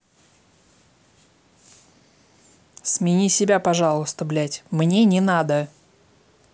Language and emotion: Russian, angry